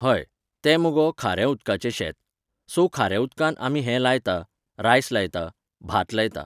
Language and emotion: Goan Konkani, neutral